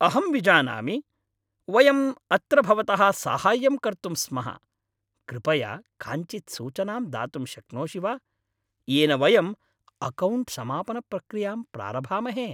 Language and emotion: Sanskrit, happy